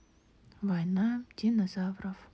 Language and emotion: Russian, neutral